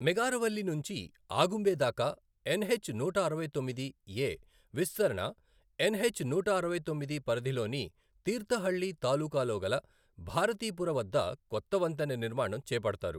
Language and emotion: Telugu, neutral